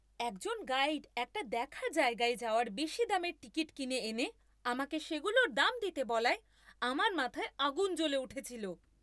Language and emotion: Bengali, angry